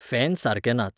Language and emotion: Goan Konkani, neutral